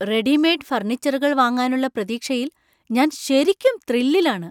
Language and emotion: Malayalam, surprised